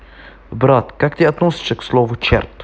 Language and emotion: Russian, neutral